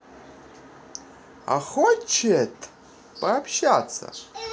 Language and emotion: Russian, positive